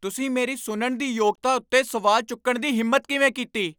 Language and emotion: Punjabi, angry